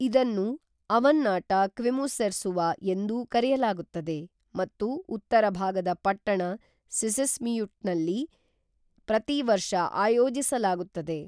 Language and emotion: Kannada, neutral